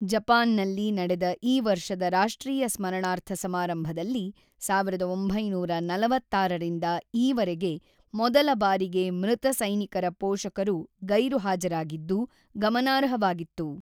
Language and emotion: Kannada, neutral